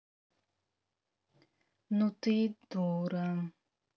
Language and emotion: Russian, neutral